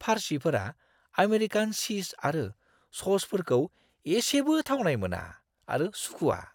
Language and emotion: Bodo, disgusted